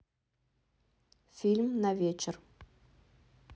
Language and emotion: Russian, neutral